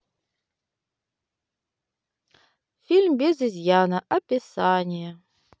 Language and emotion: Russian, neutral